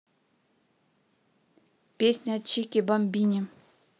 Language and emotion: Russian, neutral